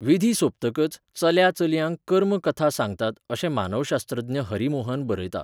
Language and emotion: Goan Konkani, neutral